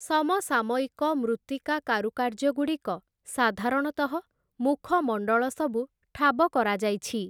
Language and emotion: Odia, neutral